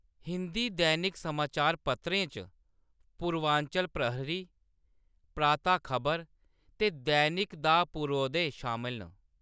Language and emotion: Dogri, neutral